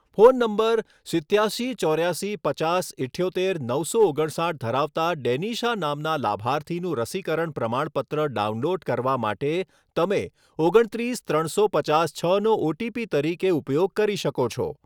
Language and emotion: Gujarati, neutral